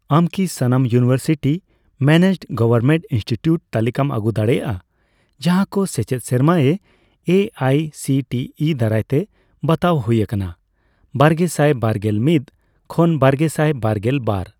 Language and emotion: Santali, neutral